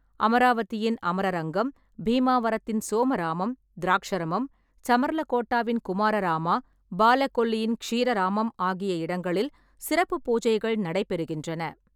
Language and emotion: Tamil, neutral